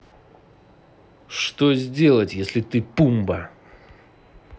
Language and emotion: Russian, angry